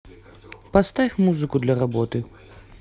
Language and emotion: Russian, neutral